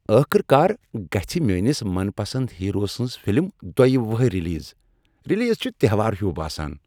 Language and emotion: Kashmiri, happy